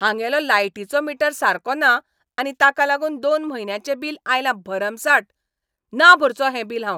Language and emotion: Goan Konkani, angry